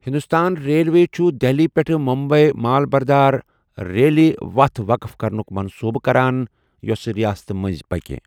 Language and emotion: Kashmiri, neutral